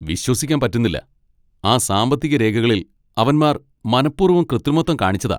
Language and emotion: Malayalam, angry